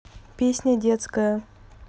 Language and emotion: Russian, neutral